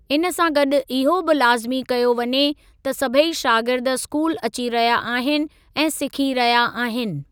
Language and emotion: Sindhi, neutral